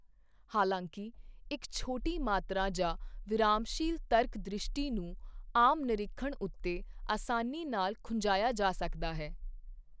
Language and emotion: Punjabi, neutral